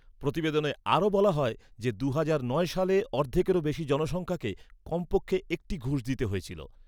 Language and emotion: Bengali, neutral